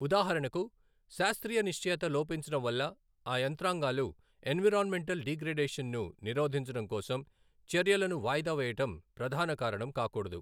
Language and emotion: Telugu, neutral